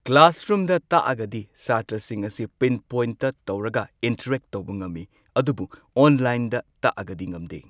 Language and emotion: Manipuri, neutral